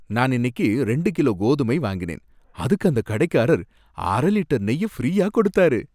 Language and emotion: Tamil, happy